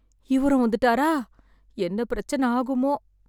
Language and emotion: Tamil, sad